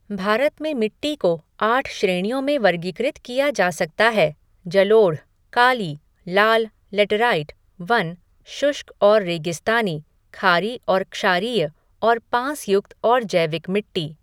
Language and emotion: Hindi, neutral